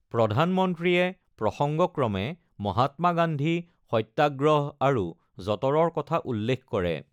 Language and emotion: Assamese, neutral